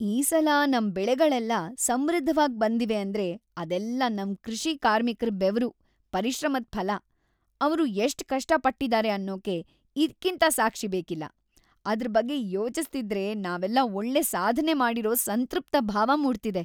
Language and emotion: Kannada, happy